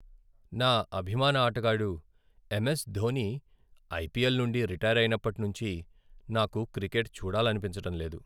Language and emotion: Telugu, sad